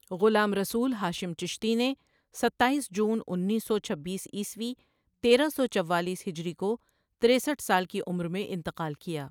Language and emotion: Urdu, neutral